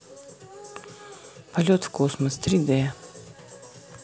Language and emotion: Russian, neutral